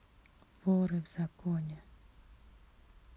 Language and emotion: Russian, neutral